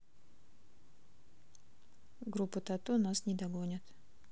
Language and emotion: Russian, neutral